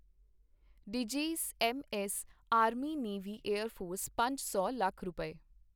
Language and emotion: Punjabi, neutral